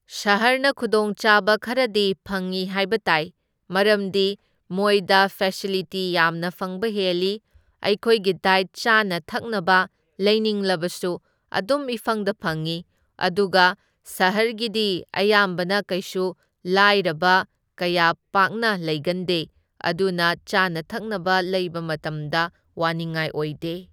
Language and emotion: Manipuri, neutral